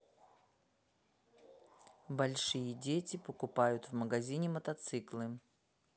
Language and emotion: Russian, neutral